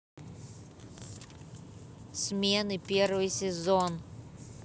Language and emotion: Russian, neutral